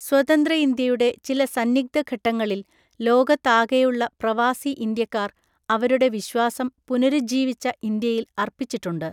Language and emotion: Malayalam, neutral